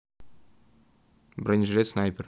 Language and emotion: Russian, neutral